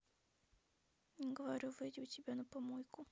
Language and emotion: Russian, sad